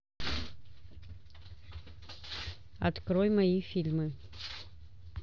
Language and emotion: Russian, neutral